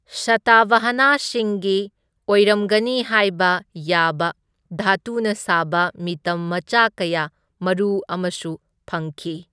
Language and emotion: Manipuri, neutral